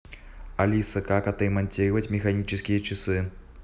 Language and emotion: Russian, neutral